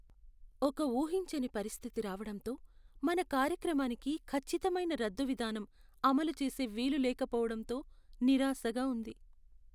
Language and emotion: Telugu, sad